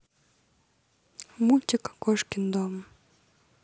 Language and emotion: Russian, neutral